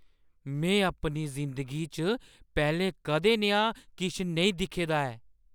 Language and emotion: Dogri, surprised